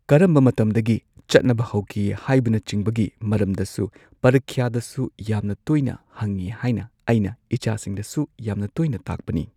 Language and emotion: Manipuri, neutral